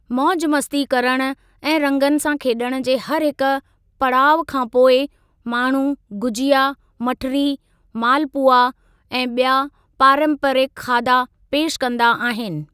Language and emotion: Sindhi, neutral